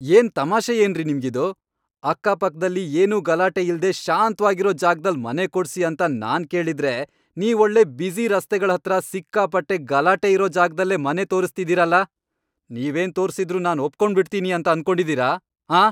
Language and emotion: Kannada, angry